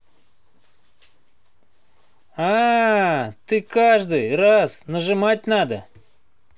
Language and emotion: Russian, positive